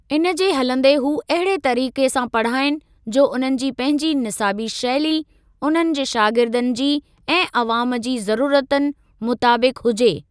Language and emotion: Sindhi, neutral